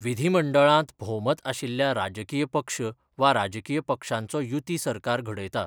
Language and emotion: Goan Konkani, neutral